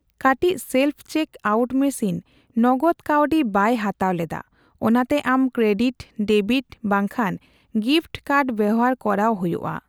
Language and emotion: Santali, neutral